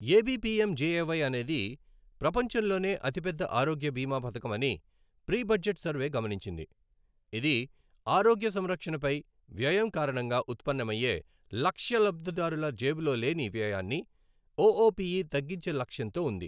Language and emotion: Telugu, neutral